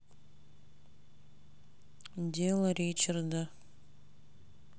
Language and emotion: Russian, neutral